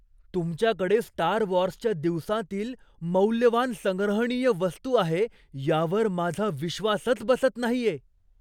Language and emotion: Marathi, surprised